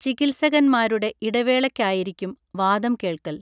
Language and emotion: Malayalam, neutral